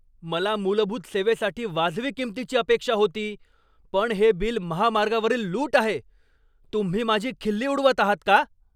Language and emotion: Marathi, angry